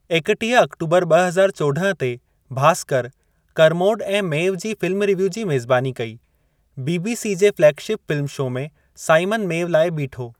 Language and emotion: Sindhi, neutral